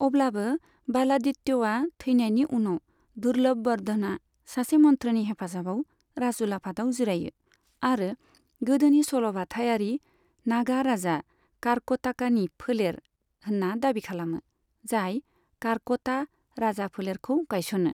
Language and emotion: Bodo, neutral